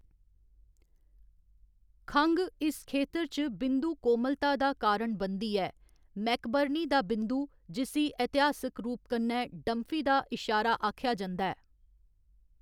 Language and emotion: Dogri, neutral